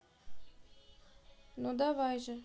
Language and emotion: Russian, neutral